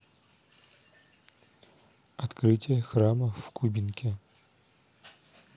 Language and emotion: Russian, neutral